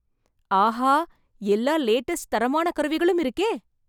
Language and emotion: Tamil, surprised